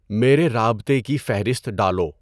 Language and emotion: Urdu, neutral